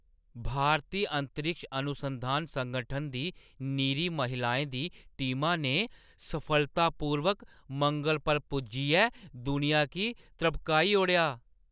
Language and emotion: Dogri, surprised